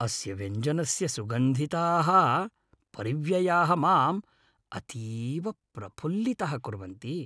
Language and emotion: Sanskrit, happy